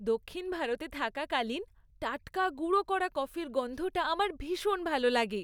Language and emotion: Bengali, happy